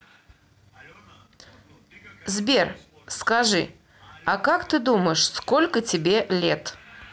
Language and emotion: Russian, neutral